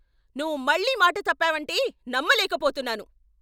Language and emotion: Telugu, angry